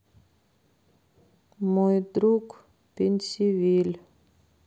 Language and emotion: Russian, sad